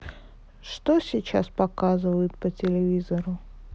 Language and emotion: Russian, sad